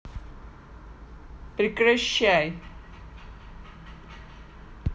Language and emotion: Russian, angry